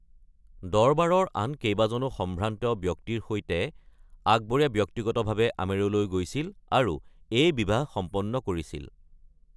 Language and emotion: Assamese, neutral